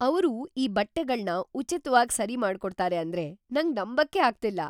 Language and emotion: Kannada, surprised